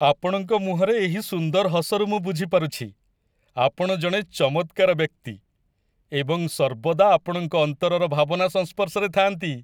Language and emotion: Odia, happy